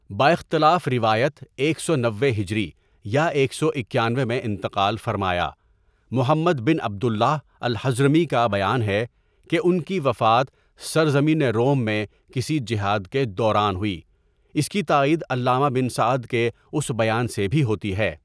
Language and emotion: Urdu, neutral